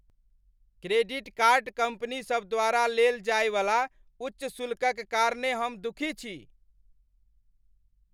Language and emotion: Maithili, angry